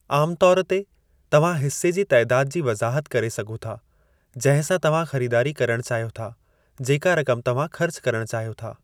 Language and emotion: Sindhi, neutral